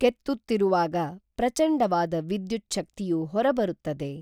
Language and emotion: Kannada, neutral